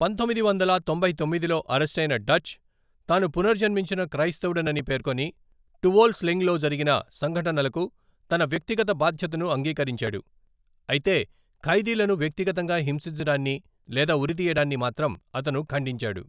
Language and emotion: Telugu, neutral